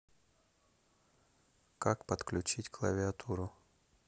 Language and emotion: Russian, neutral